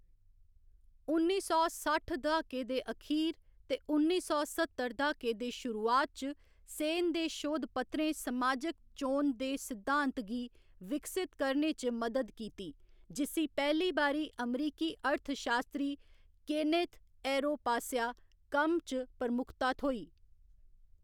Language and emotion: Dogri, neutral